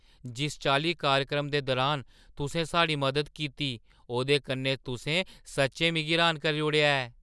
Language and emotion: Dogri, surprised